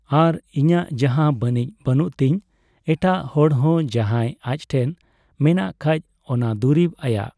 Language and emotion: Santali, neutral